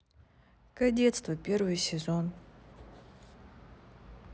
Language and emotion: Russian, sad